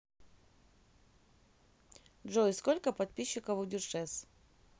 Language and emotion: Russian, neutral